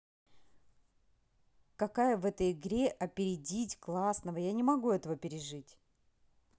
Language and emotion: Russian, neutral